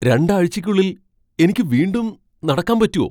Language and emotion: Malayalam, surprised